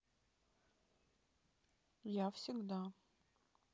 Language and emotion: Russian, neutral